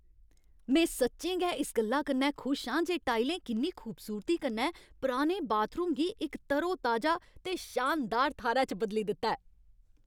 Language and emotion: Dogri, happy